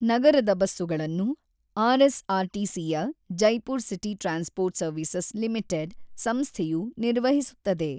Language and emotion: Kannada, neutral